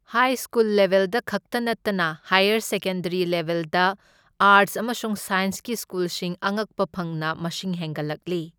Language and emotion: Manipuri, neutral